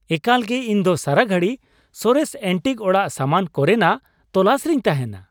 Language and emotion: Santali, happy